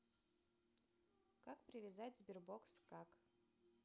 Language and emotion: Russian, neutral